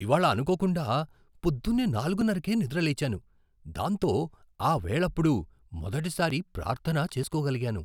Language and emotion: Telugu, surprised